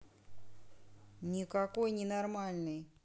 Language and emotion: Russian, angry